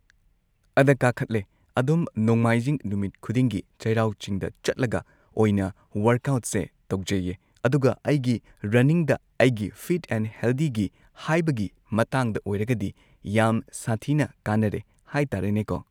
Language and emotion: Manipuri, neutral